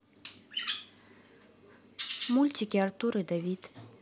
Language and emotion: Russian, neutral